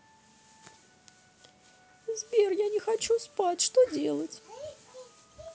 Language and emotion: Russian, sad